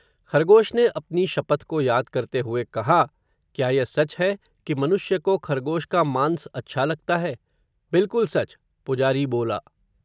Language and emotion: Hindi, neutral